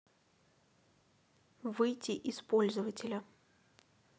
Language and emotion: Russian, neutral